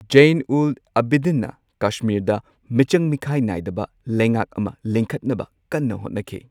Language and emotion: Manipuri, neutral